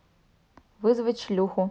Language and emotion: Russian, neutral